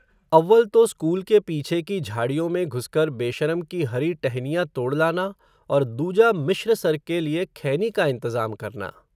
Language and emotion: Hindi, neutral